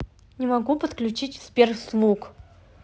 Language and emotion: Russian, neutral